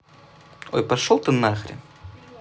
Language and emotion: Russian, angry